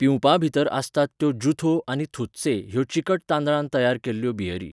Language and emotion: Goan Konkani, neutral